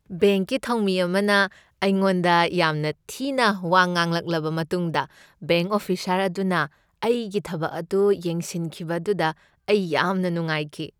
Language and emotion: Manipuri, happy